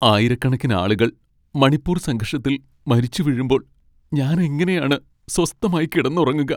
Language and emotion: Malayalam, sad